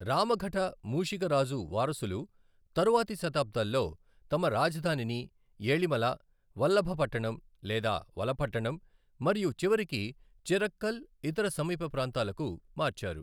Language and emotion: Telugu, neutral